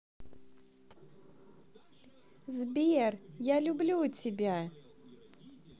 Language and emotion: Russian, positive